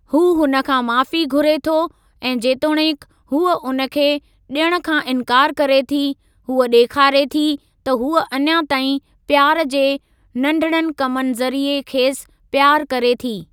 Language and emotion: Sindhi, neutral